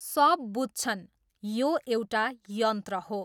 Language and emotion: Nepali, neutral